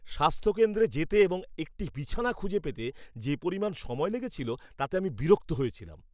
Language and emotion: Bengali, angry